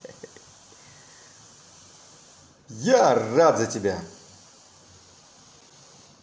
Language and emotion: Russian, positive